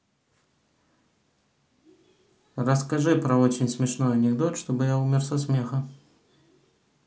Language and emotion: Russian, neutral